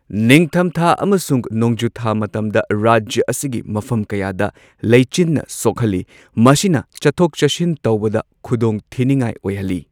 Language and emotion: Manipuri, neutral